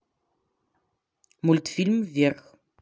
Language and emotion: Russian, neutral